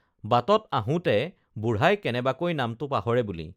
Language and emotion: Assamese, neutral